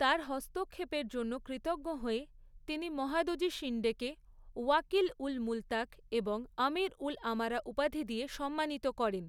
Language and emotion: Bengali, neutral